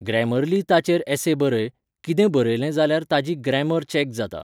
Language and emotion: Goan Konkani, neutral